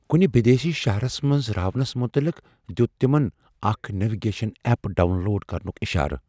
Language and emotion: Kashmiri, fearful